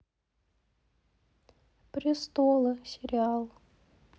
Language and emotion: Russian, sad